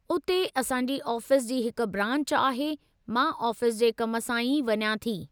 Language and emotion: Sindhi, neutral